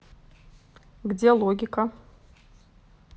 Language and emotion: Russian, neutral